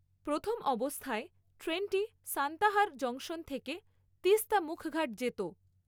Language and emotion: Bengali, neutral